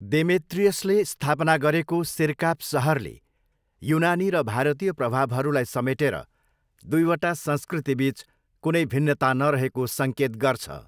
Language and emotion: Nepali, neutral